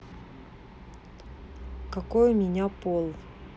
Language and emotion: Russian, neutral